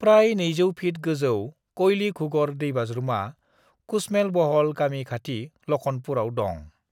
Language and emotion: Bodo, neutral